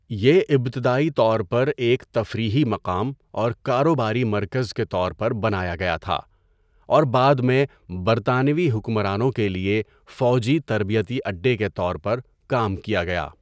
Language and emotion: Urdu, neutral